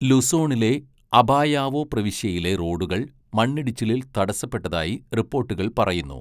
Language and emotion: Malayalam, neutral